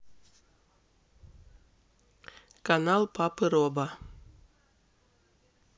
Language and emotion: Russian, neutral